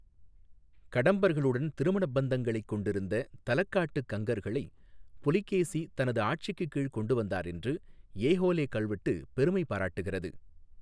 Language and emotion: Tamil, neutral